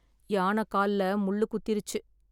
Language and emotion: Tamil, sad